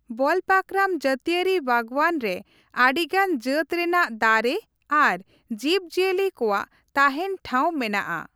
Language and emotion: Santali, neutral